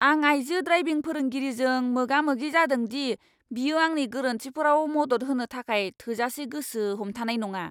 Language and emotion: Bodo, angry